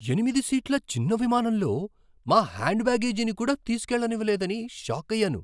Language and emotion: Telugu, surprised